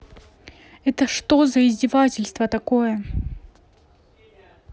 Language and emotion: Russian, angry